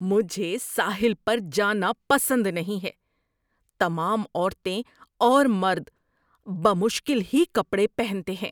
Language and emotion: Urdu, disgusted